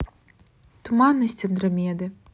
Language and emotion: Russian, neutral